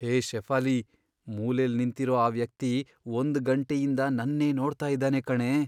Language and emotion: Kannada, fearful